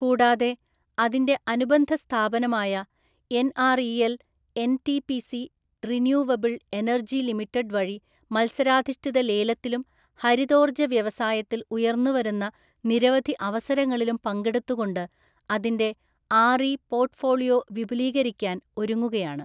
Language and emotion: Malayalam, neutral